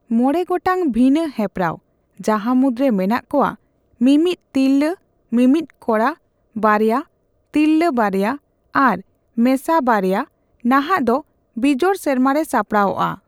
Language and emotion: Santali, neutral